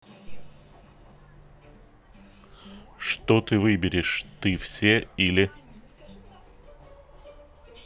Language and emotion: Russian, neutral